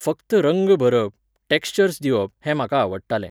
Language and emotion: Goan Konkani, neutral